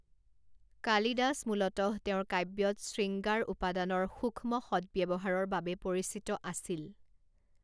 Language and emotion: Assamese, neutral